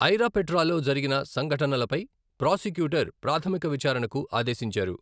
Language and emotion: Telugu, neutral